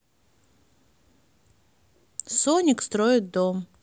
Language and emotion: Russian, neutral